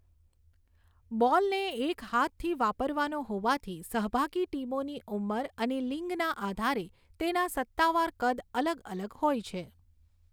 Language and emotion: Gujarati, neutral